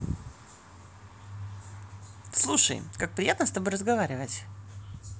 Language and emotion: Russian, positive